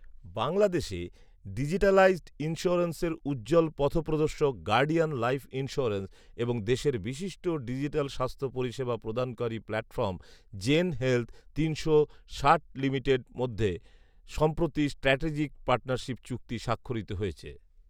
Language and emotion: Bengali, neutral